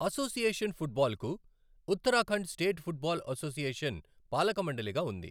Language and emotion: Telugu, neutral